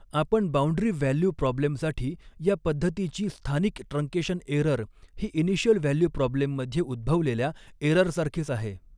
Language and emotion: Marathi, neutral